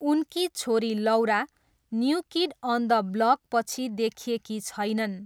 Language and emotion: Nepali, neutral